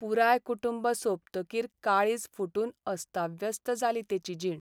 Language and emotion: Goan Konkani, sad